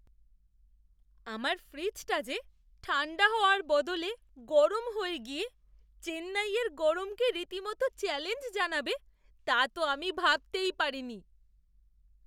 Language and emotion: Bengali, surprised